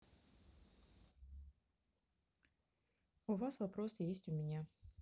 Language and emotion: Russian, neutral